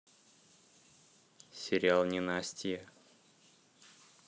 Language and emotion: Russian, neutral